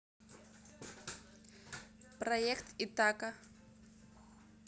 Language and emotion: Russian, neutral